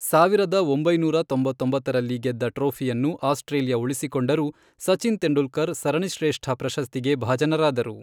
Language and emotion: Kannada, neutral